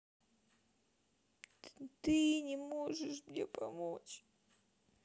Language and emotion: Russian, sad